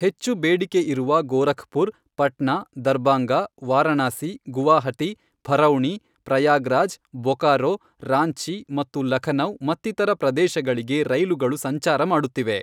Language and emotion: Kannada, neutral